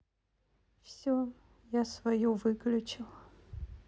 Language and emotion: Russian, sad